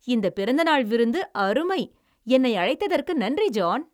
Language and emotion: Tamil, happy